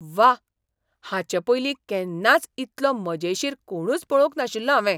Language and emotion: Goan Konkani, surprised